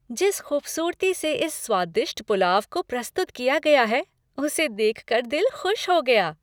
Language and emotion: Hindi, happy